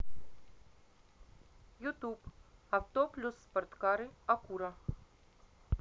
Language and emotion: Russian, neutral